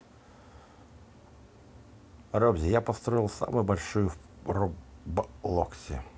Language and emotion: Russian, neutral